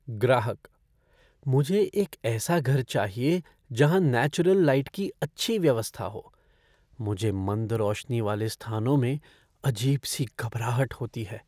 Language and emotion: Hindi, fearful